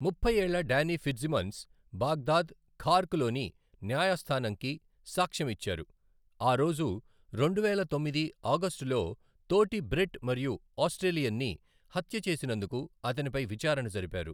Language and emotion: Telugu, neutral